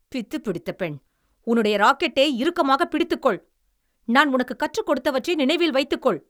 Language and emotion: Tamil, angry